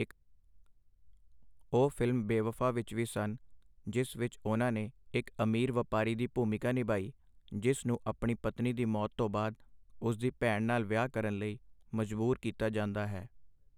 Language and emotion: Punjabi, neutral